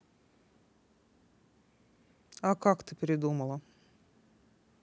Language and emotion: Russian, neutral